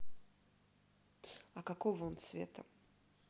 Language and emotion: Russian, neutral